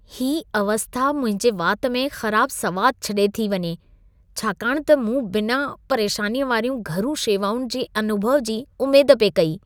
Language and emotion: Sindhi, disgusted